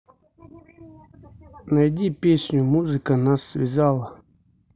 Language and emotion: Russian, neutral